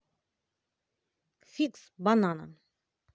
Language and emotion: Russian, neutral